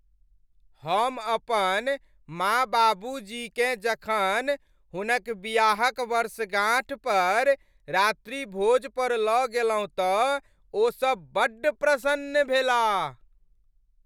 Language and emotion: Maithili, happy